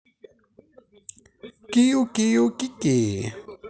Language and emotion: Russian, positive